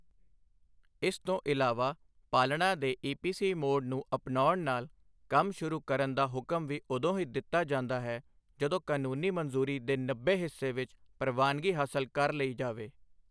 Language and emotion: Punjabi, neutral